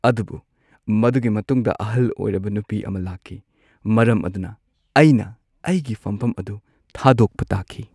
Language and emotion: Manipuri, sad